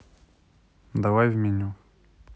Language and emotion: Russian, neutral